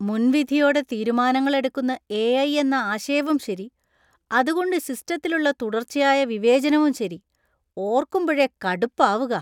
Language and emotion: Malayalam, disgusted